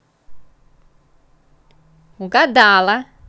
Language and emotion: Russian, positive